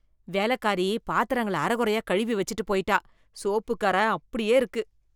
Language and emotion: Tamil, disgusted